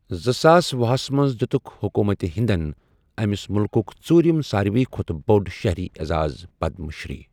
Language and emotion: Kashmiri, neutral